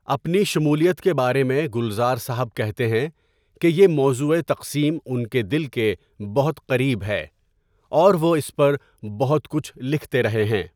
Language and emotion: Urdu, neutral